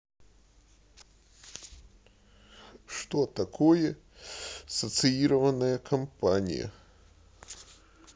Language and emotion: Russian, sad